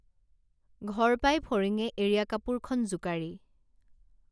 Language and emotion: Assamese, neutral